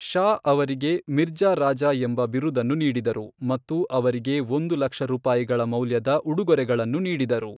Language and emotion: Kannada, neutral